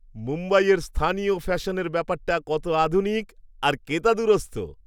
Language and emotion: Bengali, happy